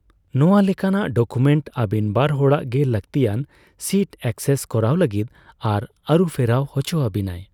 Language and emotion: Santali, neutral